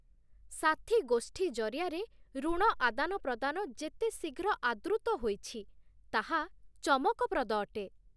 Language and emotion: Odia, surprised